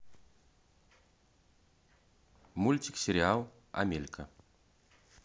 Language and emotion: Russian, neutral